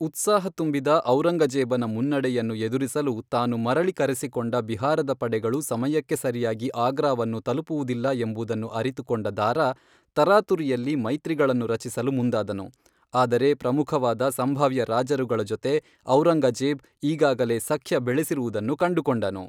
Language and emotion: Kannada, neutral